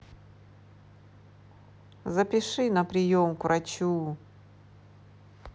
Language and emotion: Russian, neutral